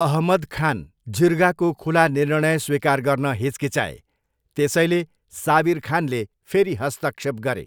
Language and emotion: Nepali, neutral